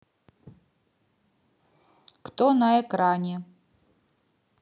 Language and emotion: Russian, neutral